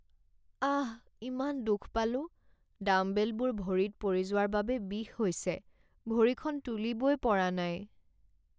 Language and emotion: Assamese, sad